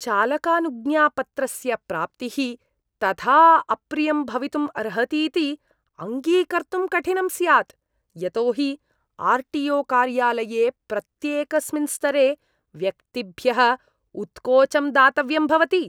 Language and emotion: Sanskrit, disgusted